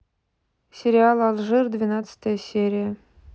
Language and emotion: Russian, neutral